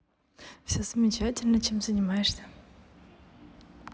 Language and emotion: Russian, positive